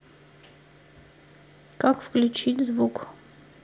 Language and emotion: Russian, neutral